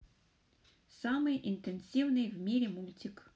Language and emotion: Russian, neutral